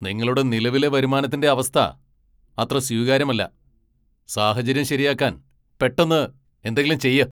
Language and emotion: Malayalam, angry